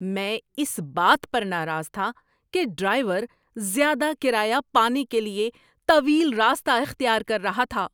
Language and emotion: Urdu, angry